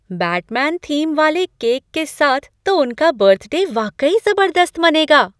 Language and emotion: Hindi, surprised